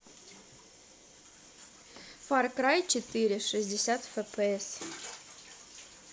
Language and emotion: Russian, neutral